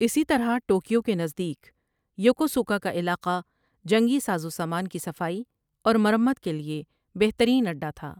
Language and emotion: Urdu, neutral